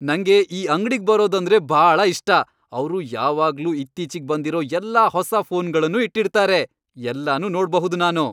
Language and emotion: Kannada, happy